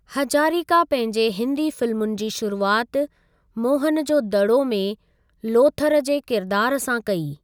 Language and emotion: Sindhi, neutral